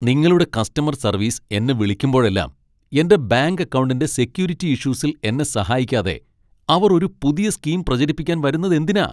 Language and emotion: Malayalam, angry